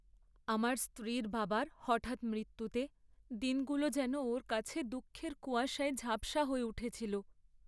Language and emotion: Bengali, sad